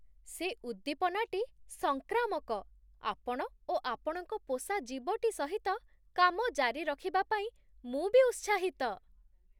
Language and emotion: Odia, surprised